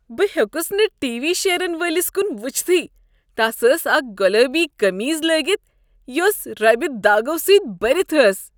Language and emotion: Kashmiri, disgusted